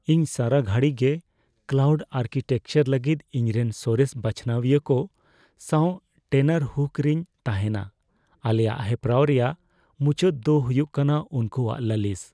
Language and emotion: Santali, fearful